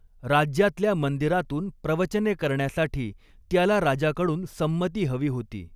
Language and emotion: Marathi, neutral